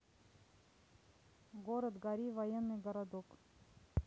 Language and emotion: Russian, neutral